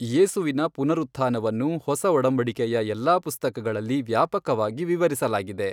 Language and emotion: Kannada, neutral